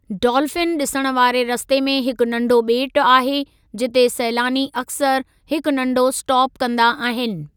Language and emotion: Sindhi, neutral